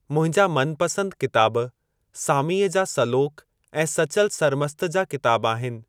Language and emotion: Sindhi, neutral